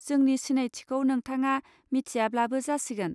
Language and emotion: Bodo, neutral